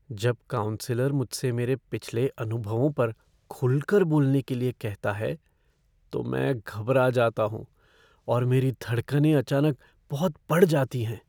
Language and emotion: Hindi, fearful